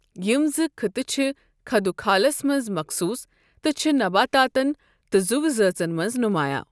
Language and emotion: Kashmiri, neutral